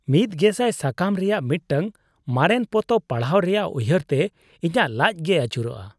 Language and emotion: Santali, disgusted